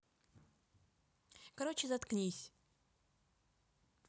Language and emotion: Russian, neutral